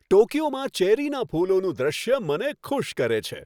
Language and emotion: Gujarati, happy